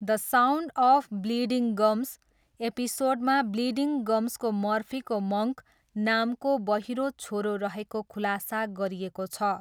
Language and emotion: Nepali, neutral